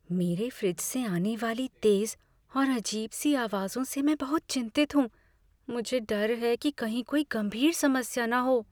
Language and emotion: Hindi, fearful